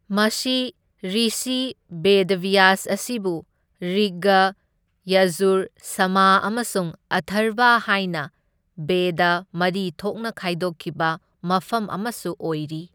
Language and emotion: Manipuri, neutral